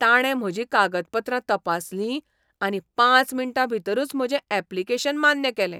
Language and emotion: Goan Konkani, surprised